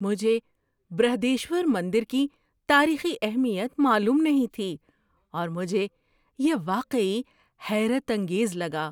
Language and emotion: Urdu, surprised